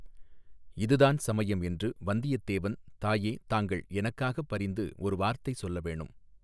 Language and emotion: Tamil, neutral